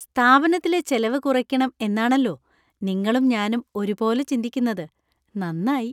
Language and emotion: Malayalam, happy